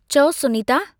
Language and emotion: Sindhi, neutral